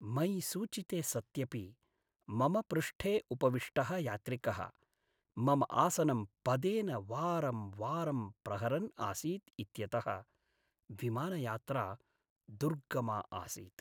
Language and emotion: Sanskrit, sad